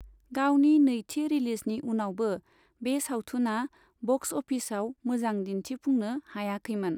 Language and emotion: Bodo, neutral